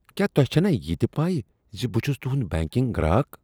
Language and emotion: Kashmiri, disgusted